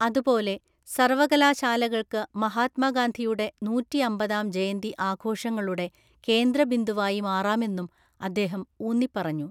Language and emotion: Malayalam, neutral